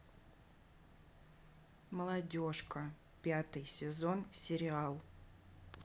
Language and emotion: Russian, neutral